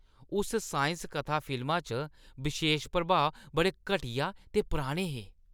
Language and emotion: Dogri, disgusted